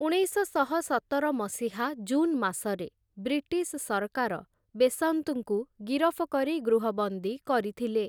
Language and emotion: Odia, neutral